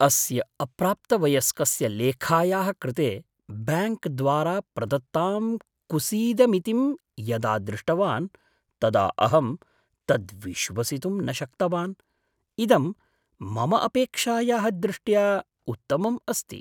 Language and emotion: Sanskrit, surprised